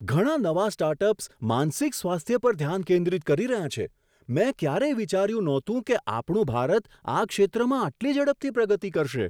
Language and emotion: Gujarati, surprised